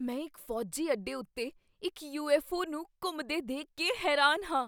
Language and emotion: Punjabi, surprised